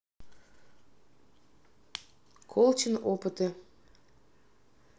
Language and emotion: Russian, neutral